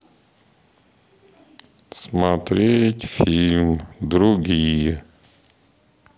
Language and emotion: Russian, sad